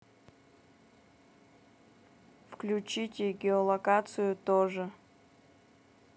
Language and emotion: Russian, neutral